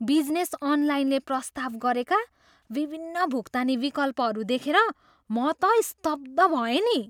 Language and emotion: Nepali, surprised